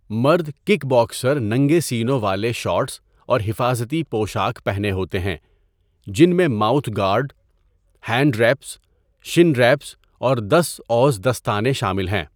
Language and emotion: Urdu, neutral